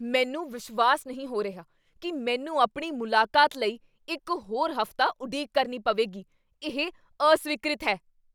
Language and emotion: Punjabi, angry